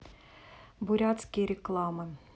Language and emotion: Russian, neutral